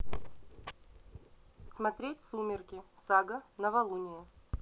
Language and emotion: Russian, neutral